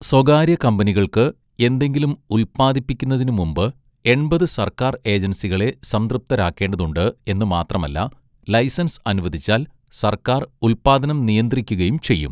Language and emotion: Malayalam, neutral